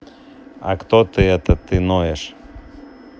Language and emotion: Russian, neutral